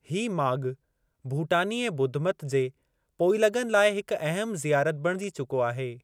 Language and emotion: Sindhi, neutral